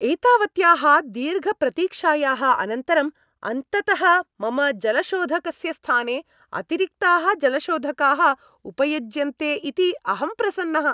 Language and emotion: Sanskrit, happy